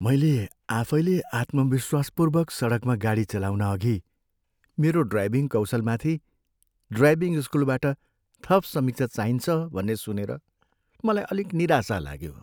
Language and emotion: Nepali, sad